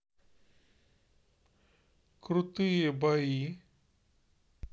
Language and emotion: Russian, neutral